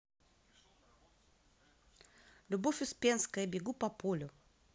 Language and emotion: Russian, positive